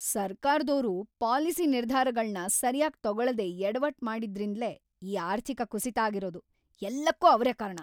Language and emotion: Kannada, angry